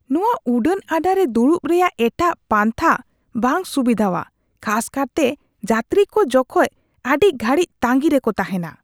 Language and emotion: Santali, disgusted